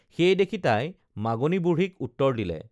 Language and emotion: Assamese, neutral